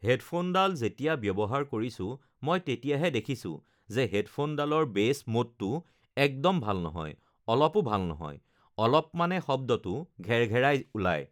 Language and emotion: Assamese, neutral